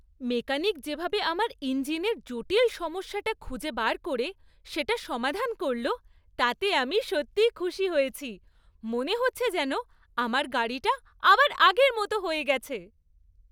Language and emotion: Bengali, happy